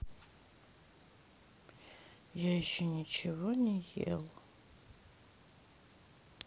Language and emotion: Russian, sad